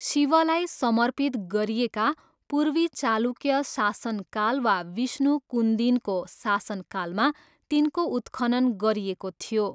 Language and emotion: Nepali, neutral